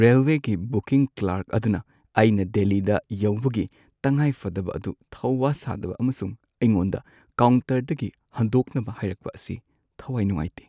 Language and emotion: Manipuri, sad